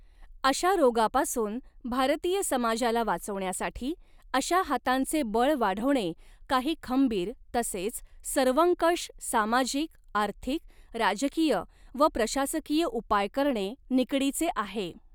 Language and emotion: Marathi, neutral